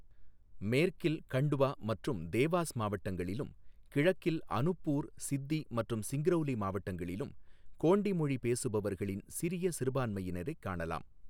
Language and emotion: Tamil, neutral